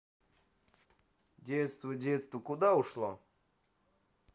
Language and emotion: Russian, sad